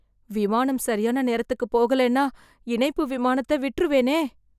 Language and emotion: Tamil, fearful